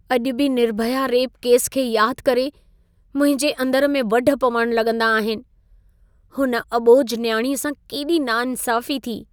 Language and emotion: Sindhi, sad